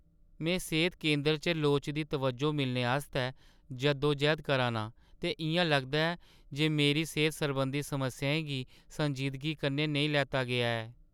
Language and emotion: Dogri, sad